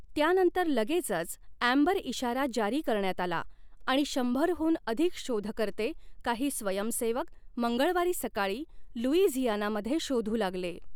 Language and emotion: Marathi, neutral